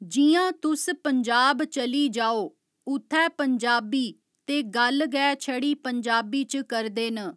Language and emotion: Dogri, neutral